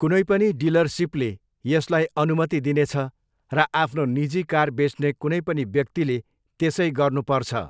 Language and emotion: Nepali, neutral